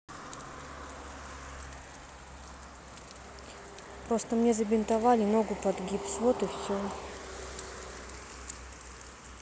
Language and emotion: Russian, sad